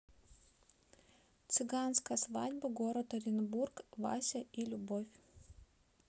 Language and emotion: Russian, neutral